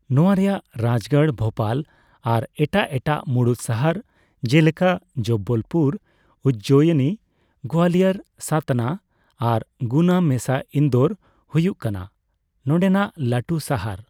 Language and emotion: Santali, neutral